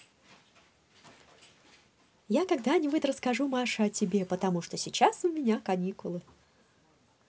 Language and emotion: Russian, positive